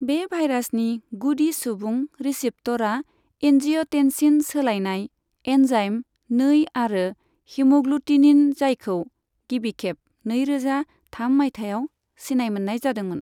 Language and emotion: Bodo, neutral